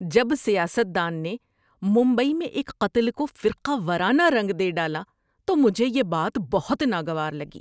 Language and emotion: Urdu, disgusted